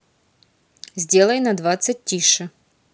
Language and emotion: Russian, neutral